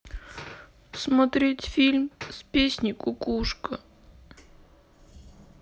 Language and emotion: Russian, sad